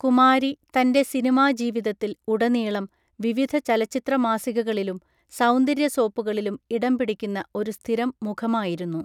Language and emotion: Malayalam, neutral